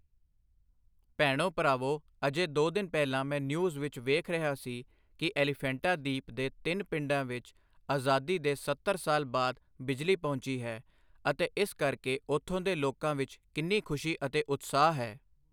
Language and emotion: Punjabi, neutral